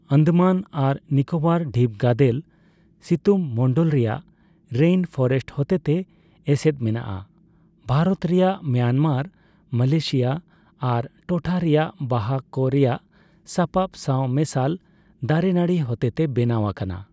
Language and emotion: Santali, neutral